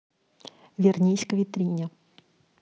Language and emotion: Russian, neutral